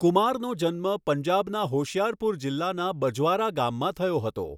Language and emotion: Gujarati, neutral